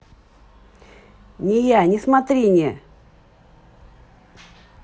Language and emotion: Russian, angry